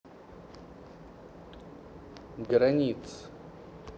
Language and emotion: Russian, neutral